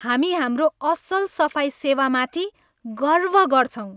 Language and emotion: Nepali, happy